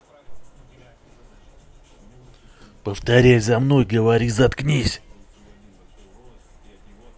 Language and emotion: Russian, angry